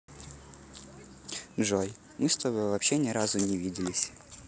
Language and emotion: Russian, neutral